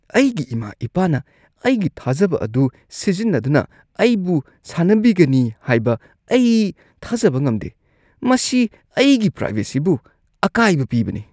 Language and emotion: Manipuri, disgusted